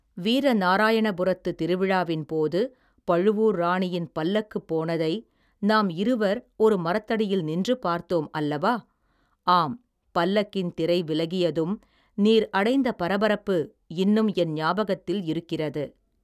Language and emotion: Tamil, neutral